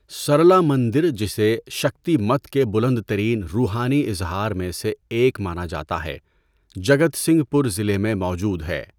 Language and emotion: Urdu, neutral